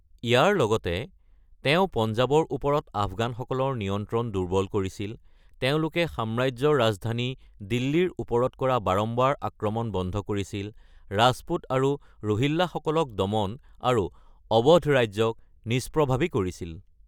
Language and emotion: Assamese, neutral